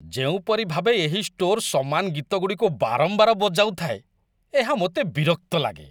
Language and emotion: Odia, disgusted